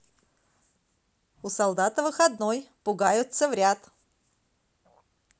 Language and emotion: Russian, positive